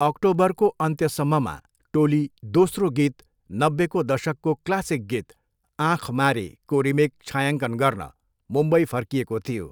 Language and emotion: Nepali, neutral